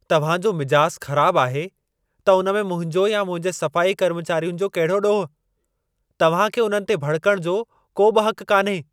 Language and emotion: Sindhi, angry